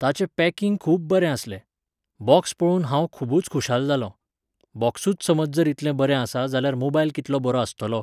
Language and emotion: Goan Konkani, neutral